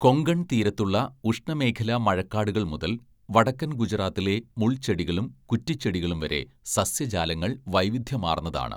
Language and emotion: Malayalam, neutral